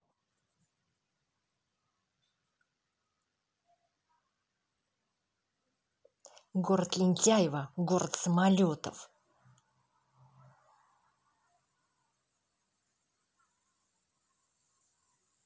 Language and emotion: Russian, angry